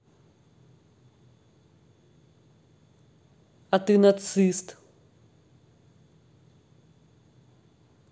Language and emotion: Russian, angry